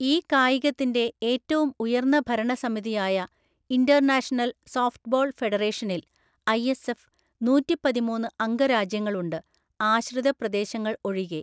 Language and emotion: Malayalam, neutral